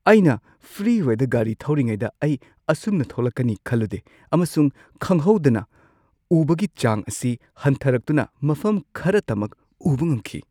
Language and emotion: Manipuri, surprised